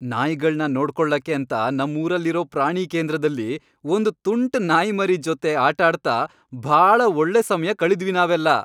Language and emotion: Kannada, happy